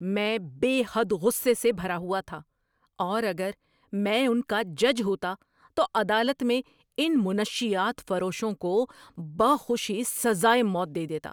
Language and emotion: Urdu, angry